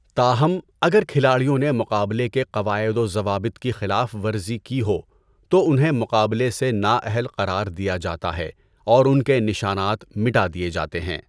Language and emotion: Urdu, neutral